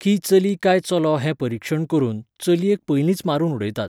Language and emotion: Goan Konkani, neutral